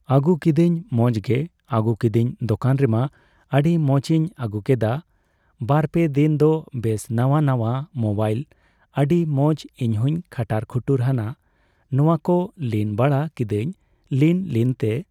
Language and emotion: Santali, neutral